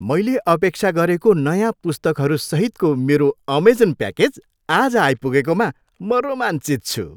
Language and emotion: Nepali, happy